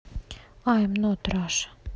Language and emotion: Russian, neutral